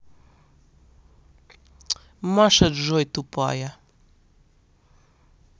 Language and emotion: Russian, angry